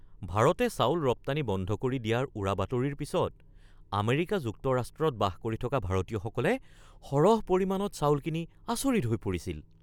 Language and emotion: Assamese, surprised